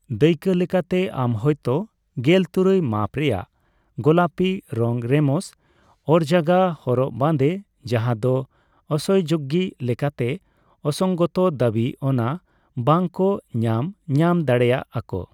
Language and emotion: Santali, neutral